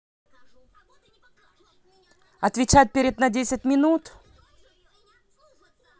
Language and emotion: Russian, angry